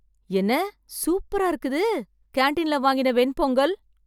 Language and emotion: Tamil, surprised